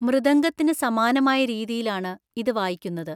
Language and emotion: Malayalam, neutral